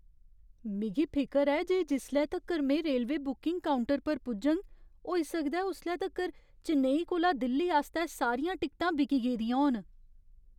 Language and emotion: Dogri, fearful